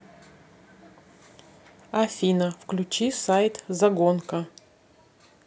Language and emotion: Russian, neutral